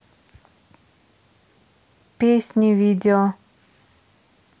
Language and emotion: Russian, neutral